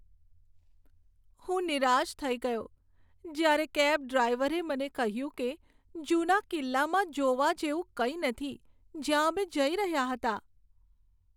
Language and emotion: Gujarati, sad